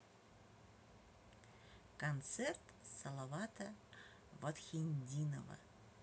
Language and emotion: Russian, neutral